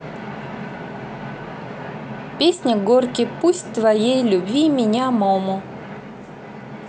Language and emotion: Russian, neutral